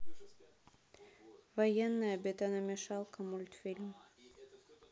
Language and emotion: Russian, neutral